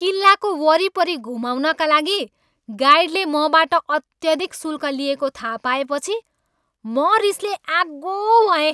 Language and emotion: Nepali, angry